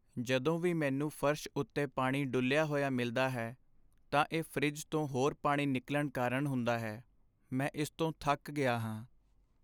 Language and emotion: Punjabi, sad